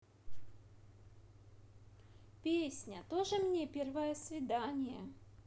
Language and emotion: Russian, positive